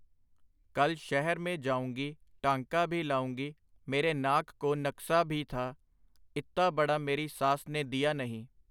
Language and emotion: Punjabi, neutral